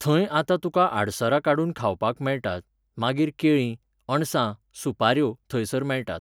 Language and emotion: Goan Konkani, neutral